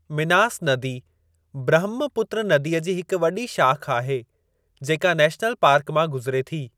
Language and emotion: Sindhi, neutral